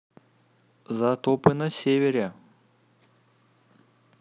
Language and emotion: Russian, neutral